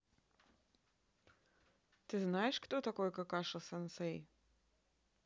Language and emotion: Russian, neutral